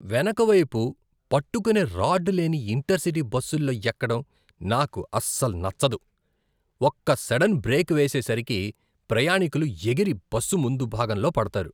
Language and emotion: Telugu, disgusted